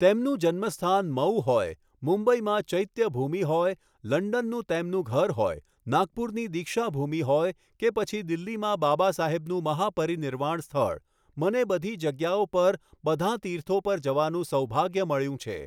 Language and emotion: Gujarati, neutral